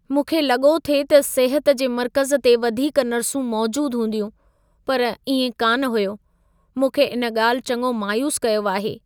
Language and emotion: Sindhi, sad